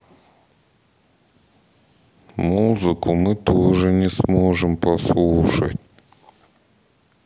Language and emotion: Russian, sad